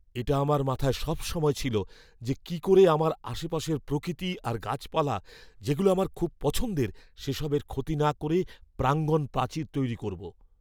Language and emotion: Bengali, fearful